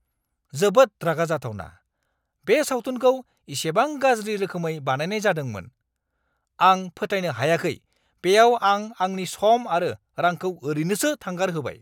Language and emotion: Bodo, angry